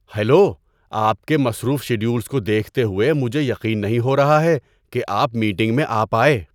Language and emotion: Urdu, surprised